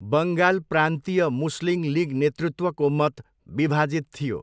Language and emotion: Nepali, neutral